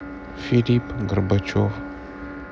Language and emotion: Russian, sad